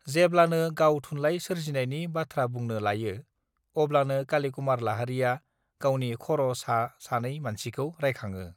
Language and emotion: Bodo, neutral